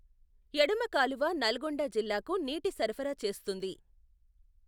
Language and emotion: Telugu, neutral